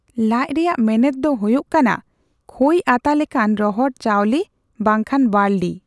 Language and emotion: Santali, neutral